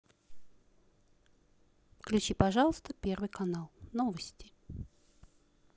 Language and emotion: Russian, neutral